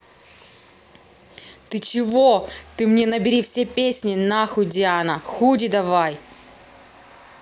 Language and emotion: Russian, angry